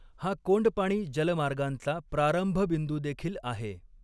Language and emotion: Marathi, neutral